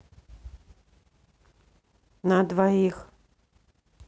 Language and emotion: Russian, neutral